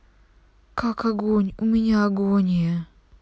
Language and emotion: Russian, sad